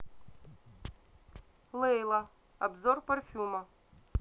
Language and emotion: Russian, neutral